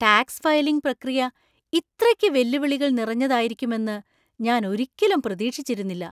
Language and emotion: Malayalam, surprised